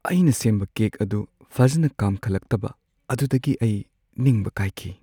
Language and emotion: Manipuri, sad